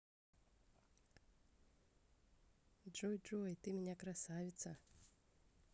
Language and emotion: Russian, positive